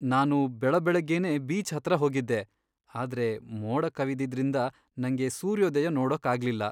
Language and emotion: Kannada, sad